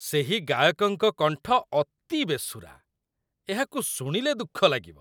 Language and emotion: Odia, disgusted